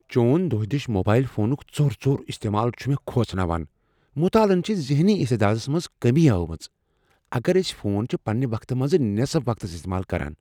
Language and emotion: Kashmiri, fearful